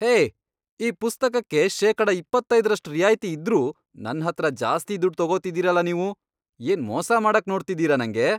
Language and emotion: Kannada, angry